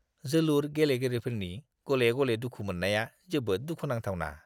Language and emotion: Bodo, disgusted